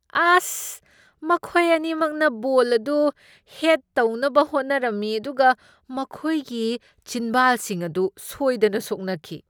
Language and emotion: Manipuri, disgusted